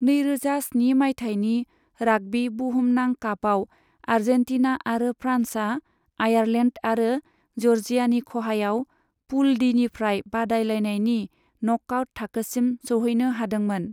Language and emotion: Bodo, neutral